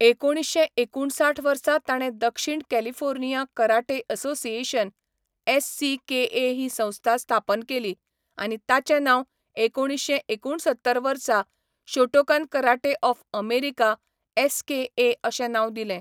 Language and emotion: Goan Konkani, neutral